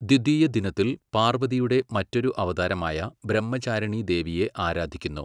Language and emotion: Malayalam, neutral